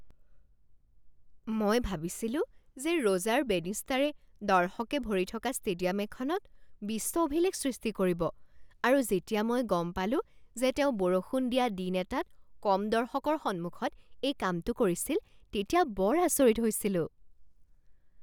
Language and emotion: Assamese, surprised